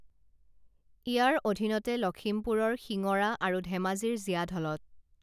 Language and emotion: Assamese, neutral